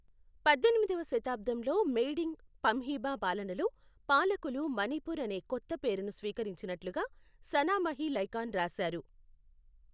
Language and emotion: Telugu, neutral